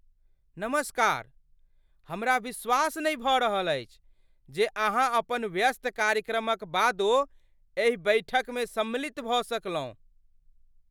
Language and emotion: Maithili, surprised